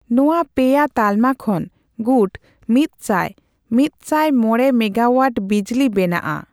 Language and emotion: Santali, neutral